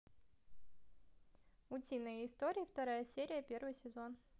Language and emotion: Russian, positive